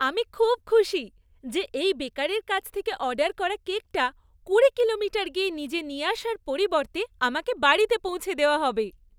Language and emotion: Bengali, happy